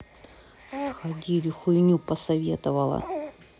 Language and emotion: Russian, sad